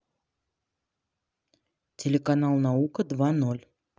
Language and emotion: Russian, neutral